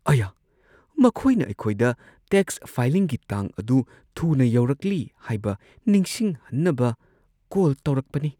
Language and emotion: Manipuri, sad